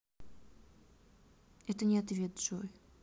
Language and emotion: Russian, neutral